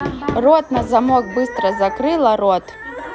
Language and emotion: Russian, angry